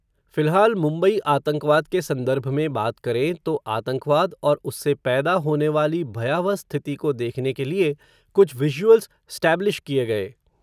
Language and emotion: Hindi, neutral